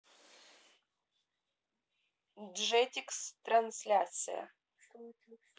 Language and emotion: Russian, neutral